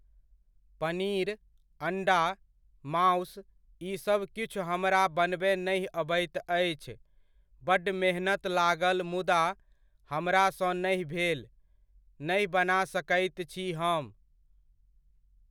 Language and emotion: Maithili, neutral